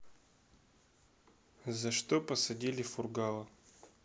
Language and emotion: Russian, neutral